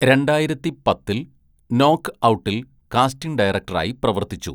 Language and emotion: Malayalam, neutral